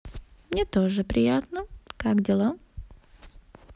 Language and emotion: Russian, positive